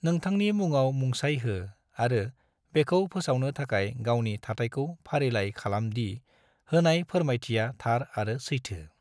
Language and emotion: Bodo, neutral